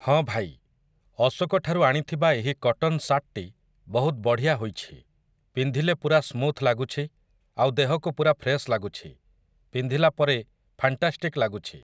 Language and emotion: Odia, neutral